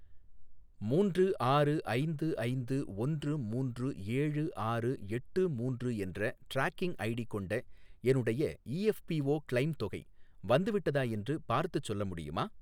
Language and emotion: Tamil, neutral